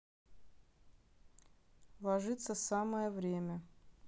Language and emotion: Russian, neutral